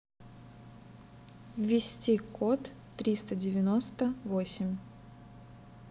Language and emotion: Russian, neutral